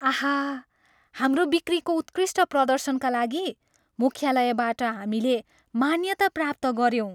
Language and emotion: Nepali, happy